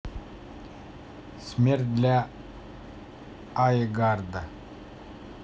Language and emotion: Russian, neutral